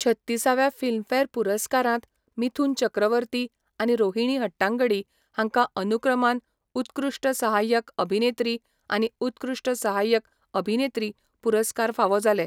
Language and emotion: Goan Konkani, neutral